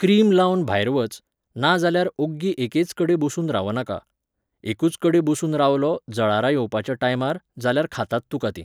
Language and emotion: Goan Konkani, neutral